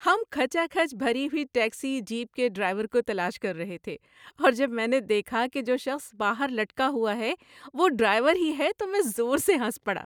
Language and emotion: Urdu, happy